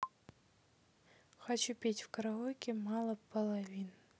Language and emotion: Russian, neutral